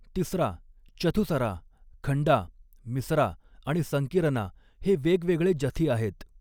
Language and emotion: Marathi, neutral